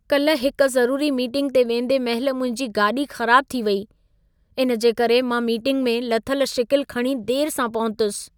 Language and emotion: Sindhi, sad